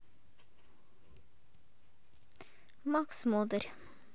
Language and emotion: Russian, neutral